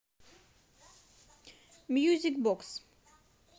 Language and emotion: Russian, positive